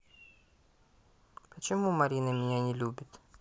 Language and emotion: Russian, sad